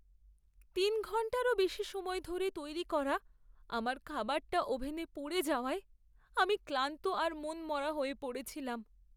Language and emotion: Bengali, sad